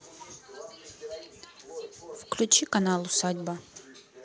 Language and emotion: Russian, neutral